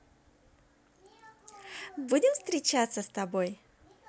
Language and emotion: Russian, positive